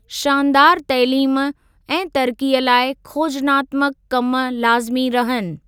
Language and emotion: Sindhi, neutral